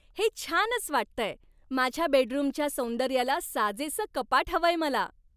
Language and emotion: Marathi, happy